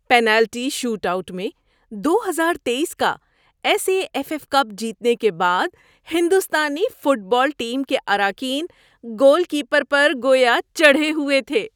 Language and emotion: Urdu, happy